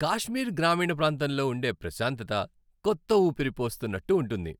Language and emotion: Telugu, happy